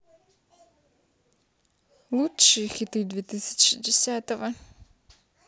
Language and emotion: Russian, neutral